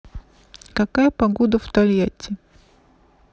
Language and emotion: Russian, neutral